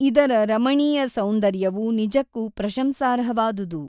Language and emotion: Kannada, neutral